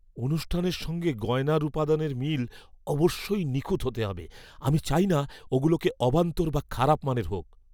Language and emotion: Bengali, fearful